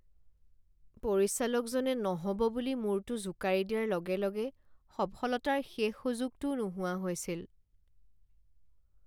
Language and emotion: Assamese, sad